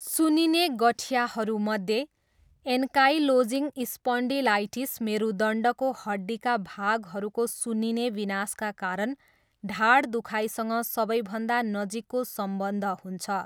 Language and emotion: Nepali, neutral